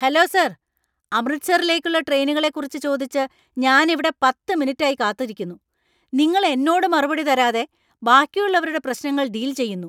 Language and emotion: Malayalam, angry